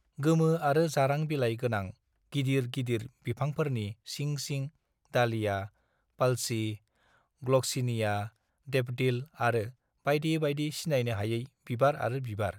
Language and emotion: Bodo, neutral